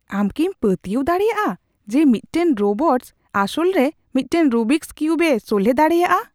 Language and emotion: Santali, surprised